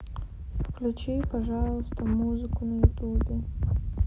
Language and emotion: Russian, sad